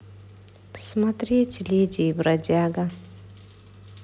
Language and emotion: Russian, sad